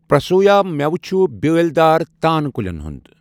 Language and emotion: Kashmiri, neutral